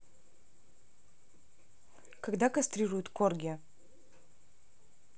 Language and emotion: Russian, neutral